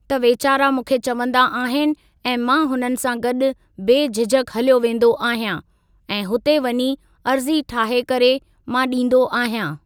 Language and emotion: Sindhi, neutral